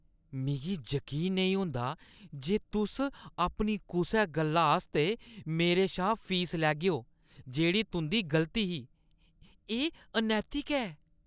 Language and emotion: Dogri, disgusted